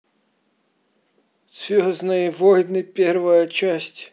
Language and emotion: Russian, neutral